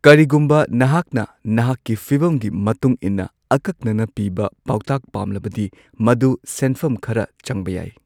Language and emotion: Manipuri, neutral